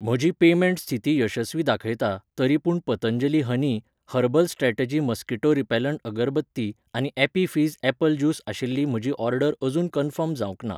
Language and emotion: Goan Konkani, neutral